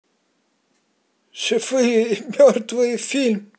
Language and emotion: Russian, positive